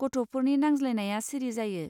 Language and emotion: Bodo, neutral